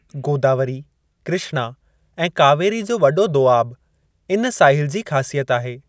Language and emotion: Sindhi, neutral